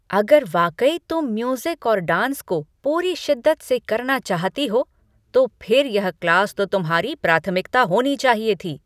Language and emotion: Hindi, angry